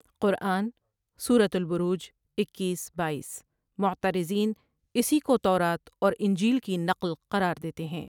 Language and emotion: Urdu, neutral